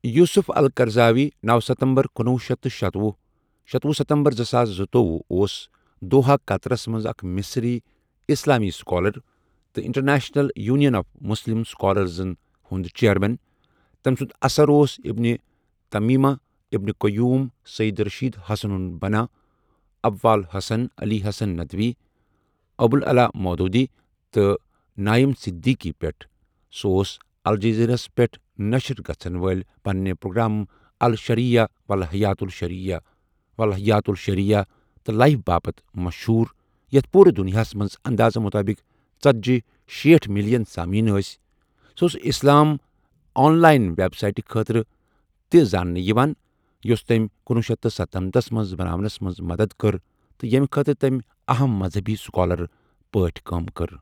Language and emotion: Kashmiri, neutral